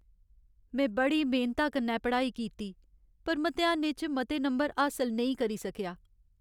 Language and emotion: Dogri, sad